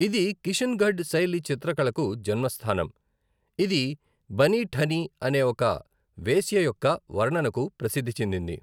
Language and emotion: Telugu, neutral